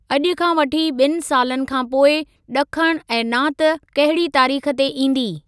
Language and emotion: Sindhi, neutral